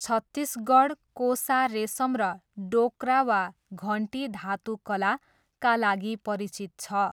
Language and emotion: Nepali, neutral